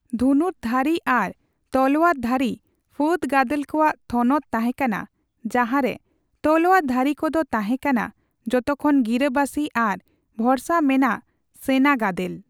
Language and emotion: Santali, neutral